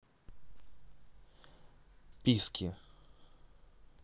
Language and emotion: Russian, neutral